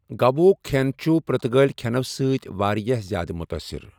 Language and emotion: Kashmiri, neutral